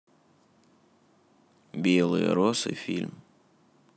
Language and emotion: Russian, neutral